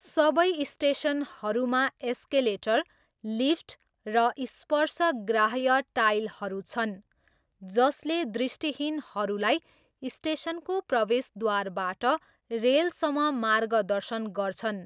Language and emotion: Nepali, neutral